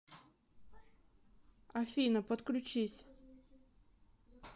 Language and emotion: Russian, neutral